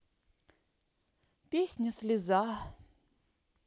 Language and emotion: Russian, sad